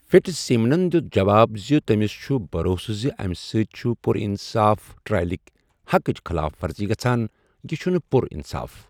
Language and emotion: Kashmiri, neutral